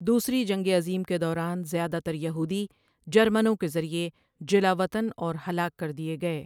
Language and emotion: Urdu, neutral